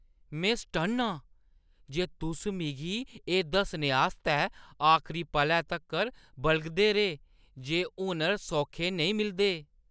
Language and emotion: Dogri, disgusted